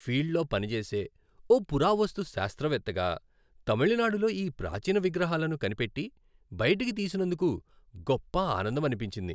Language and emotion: Telugu, happy